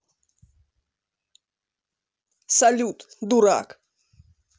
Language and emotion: Russian, angry